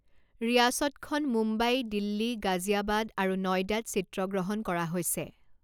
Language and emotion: Assamese, neutral